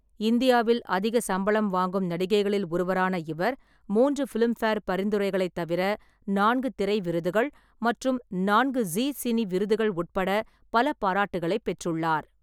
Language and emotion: Tamil, neutral